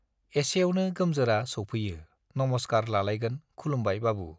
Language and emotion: Bodo, neutral